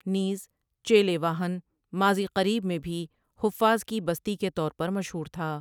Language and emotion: Urdu, neutral